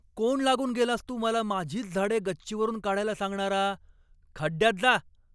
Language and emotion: Marathi, angry